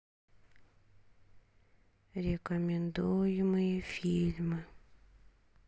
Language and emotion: Russian, sad